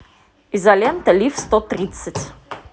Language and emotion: Russian, positive